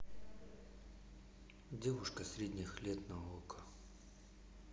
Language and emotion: Russian, sad